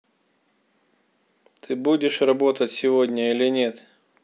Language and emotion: Russian, angry